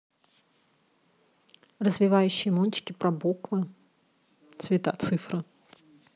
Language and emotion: Russian, neutral